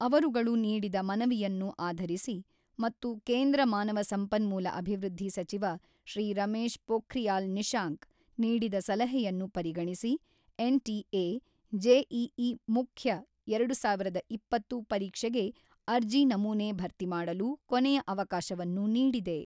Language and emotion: Kannada, neutral